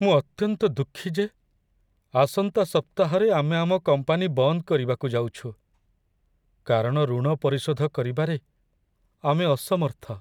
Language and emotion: Odia, sad